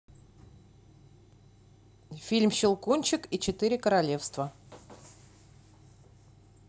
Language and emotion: Russian, neutral